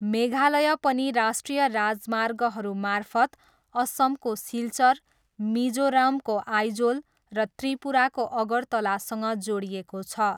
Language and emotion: Nepali, neutral